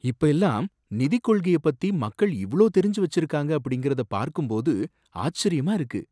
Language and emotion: Tamil, surprised